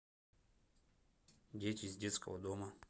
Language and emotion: Russian, neutral